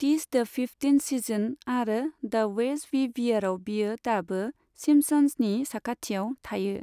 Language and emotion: Bodo, neutral